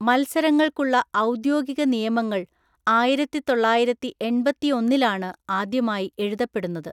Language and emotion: Malayalam, neutral